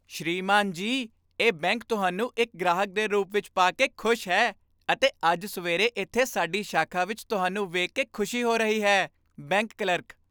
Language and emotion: Punjabi, happy